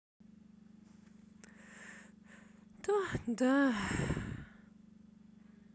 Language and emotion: Russian, sad